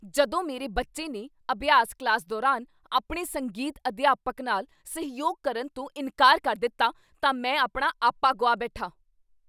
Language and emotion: Punjabi, angry